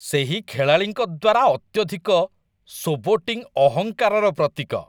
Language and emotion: Odia, disgusted